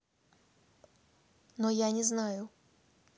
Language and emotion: Russian, neutral